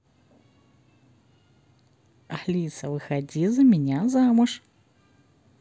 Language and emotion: Russian, positive